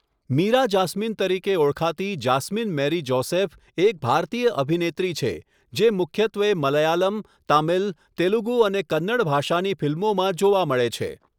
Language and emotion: Gujarati, neutral